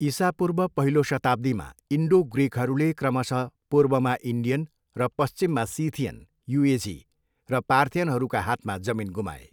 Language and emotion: Nepali, neutral